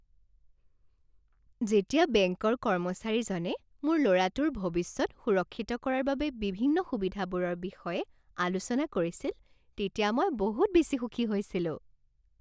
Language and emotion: Assamese, happy